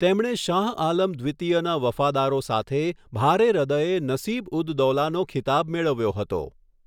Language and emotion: Gujarati, neutral